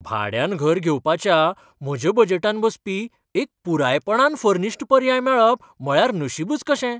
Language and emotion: Goan Konkani, surprised